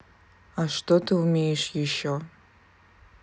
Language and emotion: Russian, neutral